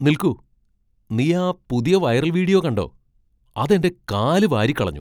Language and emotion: Malayalam, surprised